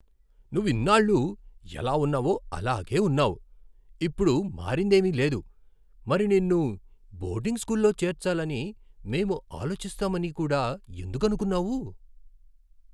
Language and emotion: Telugu, surprised